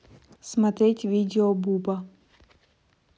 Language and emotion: Russian, neutral